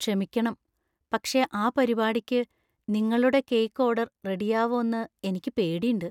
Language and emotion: Malayalam, fearful